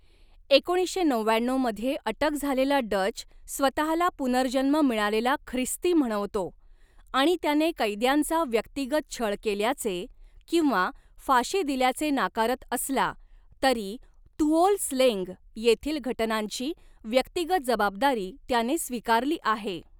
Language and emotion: Marathi, neutral